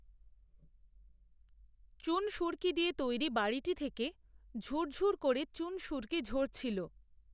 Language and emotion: Bengali, neutral